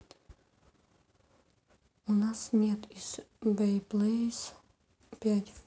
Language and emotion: Russian, neutral